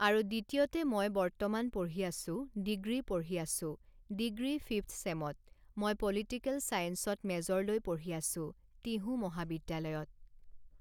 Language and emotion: Assamese, neutral